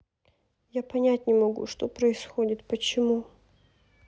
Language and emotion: Russian, sad